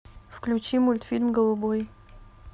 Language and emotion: Russian, neutral